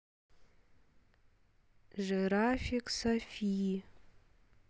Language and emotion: Russian, neutral